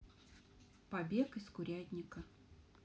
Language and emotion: Russian, neutral